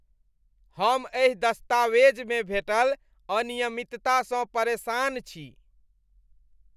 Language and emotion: Maithili, disgusted